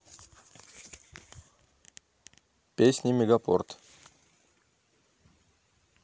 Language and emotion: Russian, neutral